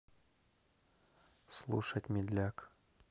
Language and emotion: Russian, neutral